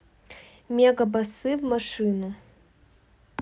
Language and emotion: Russian, neutral